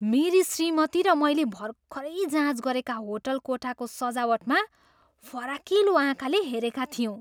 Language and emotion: Nepali, surprised